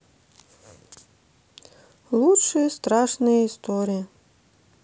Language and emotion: Russian, neutral